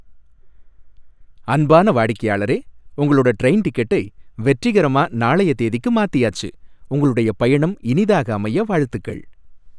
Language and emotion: Tamil, happy